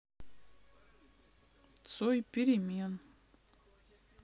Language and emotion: Russian, neutral